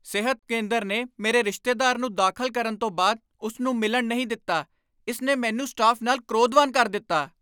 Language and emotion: Punjabi, angry